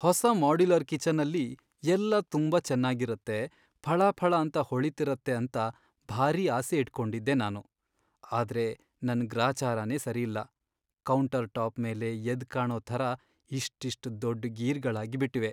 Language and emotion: Kannada, sad